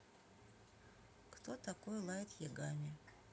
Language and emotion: Russian, neutral